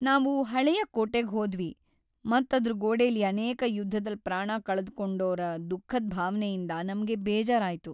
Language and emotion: Kannada, sad